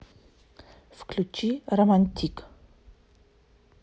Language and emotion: Russian, neutral